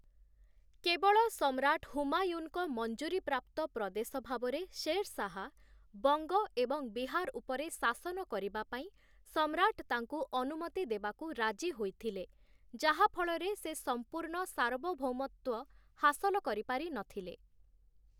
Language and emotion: Odia, neutral